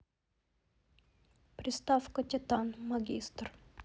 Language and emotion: Russian, neutral